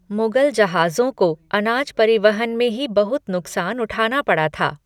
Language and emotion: Hindi, neutral